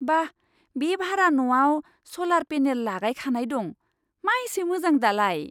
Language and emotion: Bodo, surprised